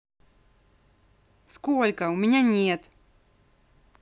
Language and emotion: Russian, angry